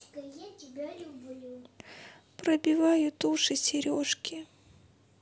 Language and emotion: Russian, sad